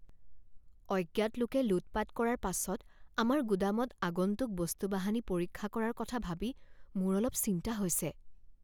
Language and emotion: Assamese, fearful